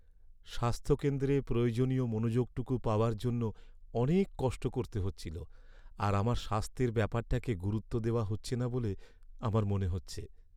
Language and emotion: Bengali, sad